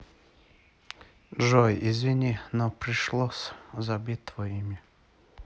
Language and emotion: Russian, sad